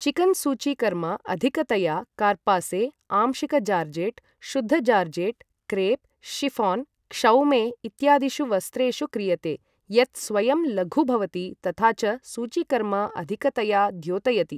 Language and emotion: Sanskrit, neutral